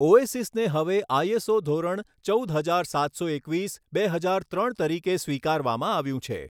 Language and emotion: Gujarati, neutral